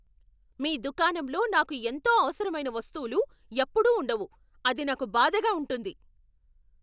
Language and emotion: Telugu, angry